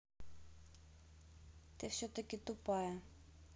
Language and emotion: Russian, neutral